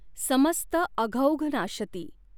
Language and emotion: Marathi, neutral